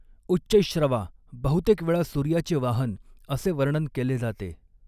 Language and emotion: Marathi, neutral